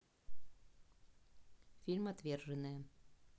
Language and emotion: Russian, neutral